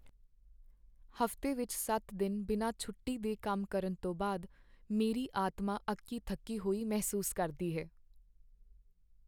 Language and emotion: Punjabi, sad